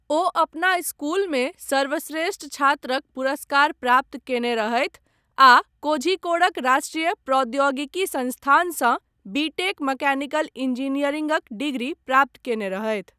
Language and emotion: Maithili, neutral